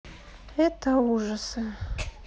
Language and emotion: Russian, sad